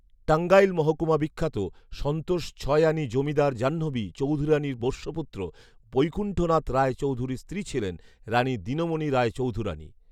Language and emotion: Bengali, neutral